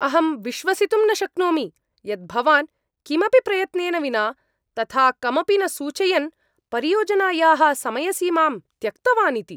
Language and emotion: Sanskrit, angry